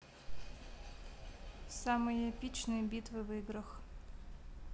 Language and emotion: Russian, neutral